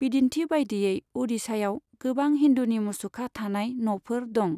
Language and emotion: Bodo, neutral